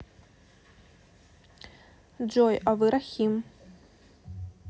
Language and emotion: Russian, neutral